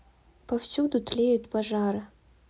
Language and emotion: Russian, neutral